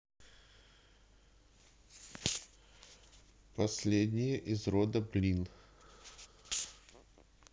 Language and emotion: Russian, neutral